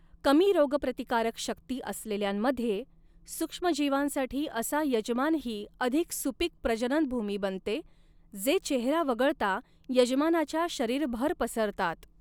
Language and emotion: Marathi, neutral